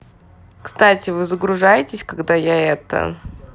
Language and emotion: Russian, neutral